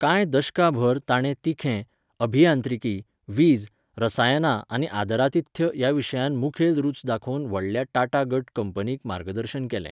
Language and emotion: Goan Konkani, neutral